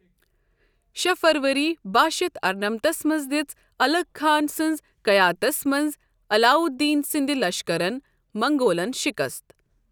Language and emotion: Kashmiri, neutral